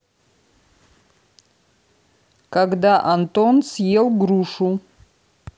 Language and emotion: Russian, neutral